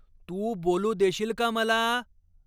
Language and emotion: Marathi, angry